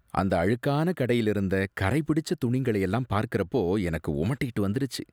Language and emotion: Tamil, disgusted